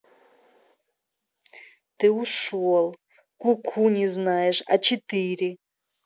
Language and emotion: Russian, neutral